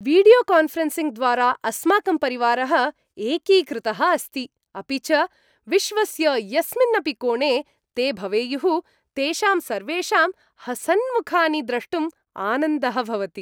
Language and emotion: Sanskrit, happy